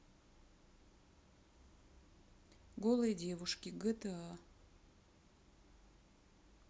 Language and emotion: Russian, neutral